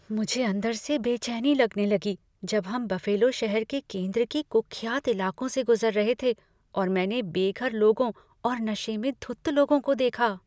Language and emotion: Hindi, fearful